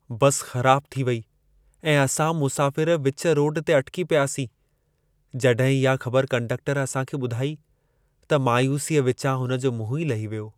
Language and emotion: Sindhi, sad